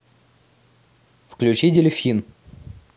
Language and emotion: Russian, neutral